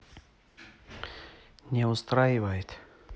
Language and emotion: Russian, neutral